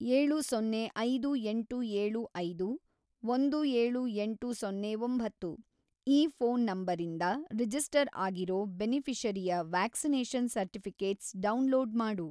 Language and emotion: Kannada, neutral